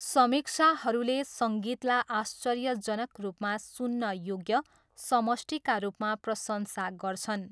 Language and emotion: Nepali, neutral